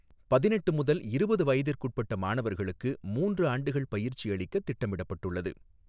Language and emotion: Tamil, neutral